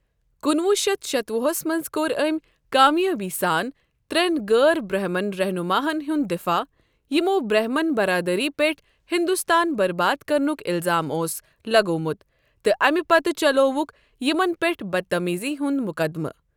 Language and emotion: Kashmiri, neutral